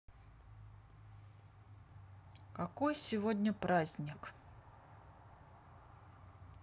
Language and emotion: Russian, neutral